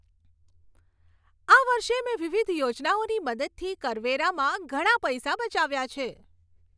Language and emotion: Gujarati, happy